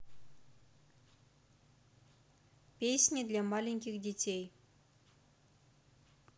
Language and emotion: Russian, neutral